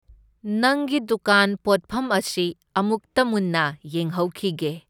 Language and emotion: Manipuri, neutral